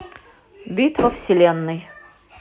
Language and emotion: Russian, neutral